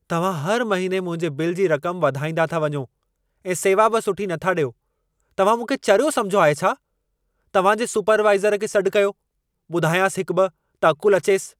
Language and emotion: Sindhi, angry